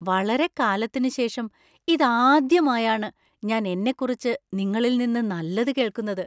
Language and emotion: Malayalam, surprised